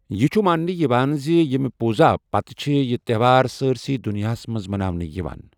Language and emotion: Kashmiri, neutral